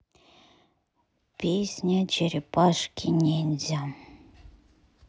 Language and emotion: Russian, sad